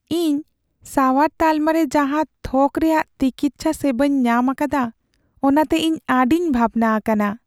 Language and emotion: Santali, sad